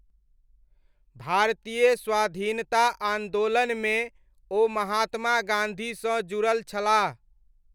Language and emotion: Maithili, neutral